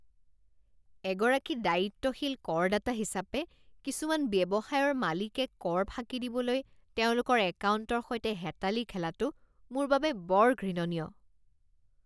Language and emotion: Assamese, disgusted